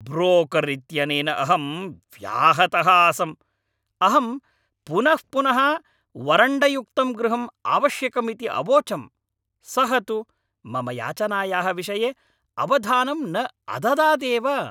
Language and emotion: Sanskrit, angry